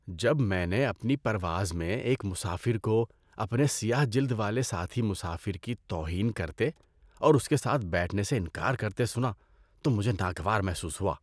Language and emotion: Urdu, disgusted